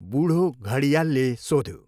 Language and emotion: Nepali, neutral